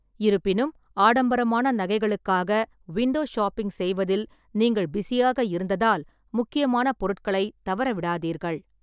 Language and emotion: Tamil, neutral